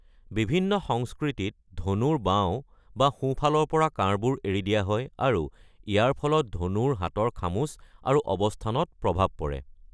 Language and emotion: Assamese, neutral